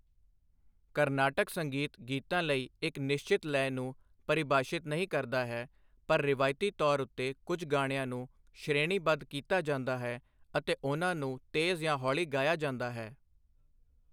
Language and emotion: Punjabi, neutral